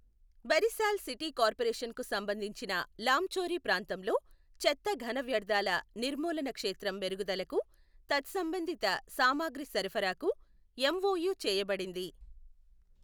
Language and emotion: Telugu, neutral